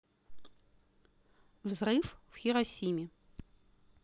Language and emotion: Russian, neutral